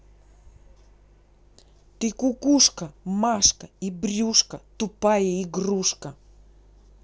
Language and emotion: Russian, angry